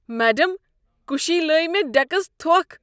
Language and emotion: Kashmiri, disgusted